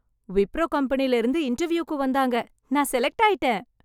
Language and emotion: Tamil, happy